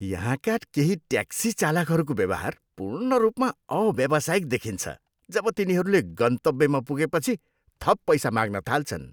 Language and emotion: Nepali, disgusted